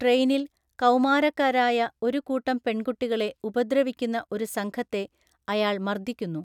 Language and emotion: Malayalam, neutral